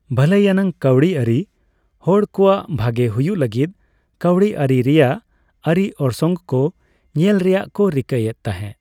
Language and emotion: Santali, neutral